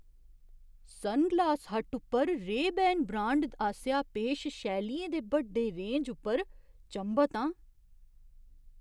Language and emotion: Dogri, surprised